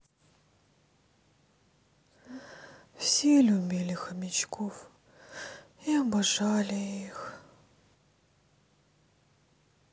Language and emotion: Russian, sad